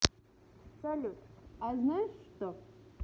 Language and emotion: Russian, positive